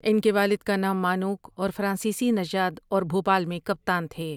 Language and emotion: Urdu, neutral